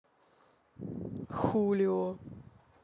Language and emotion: Russian, neutral